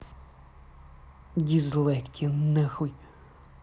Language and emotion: Russian, angry